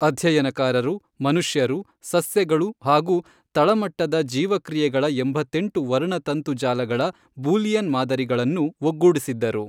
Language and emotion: Kannada, neutral